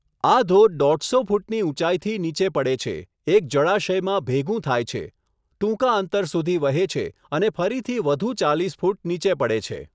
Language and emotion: Gujarati, neutral